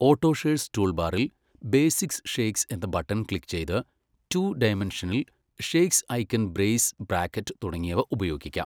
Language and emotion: Malayalam, neutral